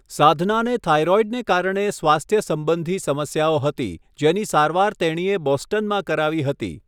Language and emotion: Gujarati, neutral